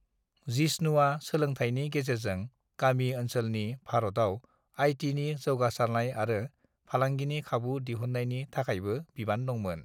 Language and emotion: Bodo, neutral